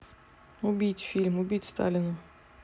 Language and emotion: Russian, neutral